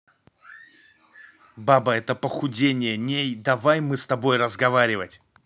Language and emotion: Russian, angry